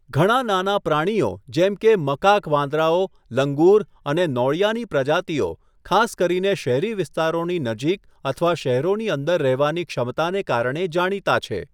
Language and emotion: Gujarati, neutral